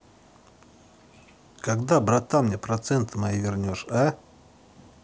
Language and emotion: Russian, angry